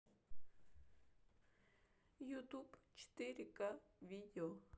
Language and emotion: Russian, sad